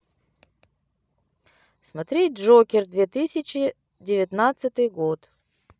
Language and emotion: Russian, neutral